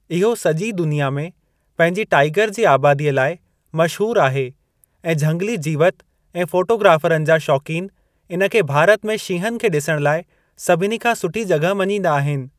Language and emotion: Sindhi, neutral